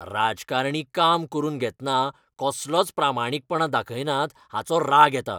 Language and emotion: Goan Konkani, angry